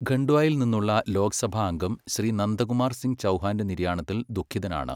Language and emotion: Malayalam, neutral